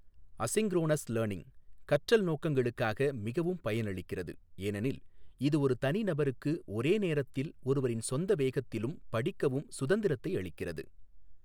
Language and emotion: Tamil, neutral